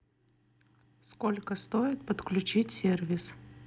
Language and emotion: Russian, neutral